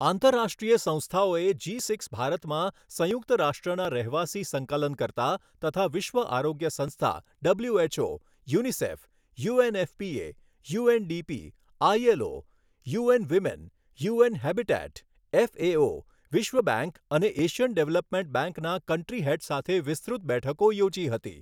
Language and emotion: Gujarati, neutral